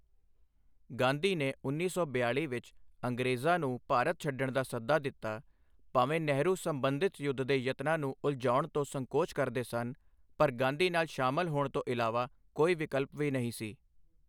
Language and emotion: Punjabi, neutral